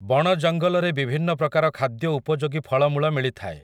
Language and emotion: Odia, neutral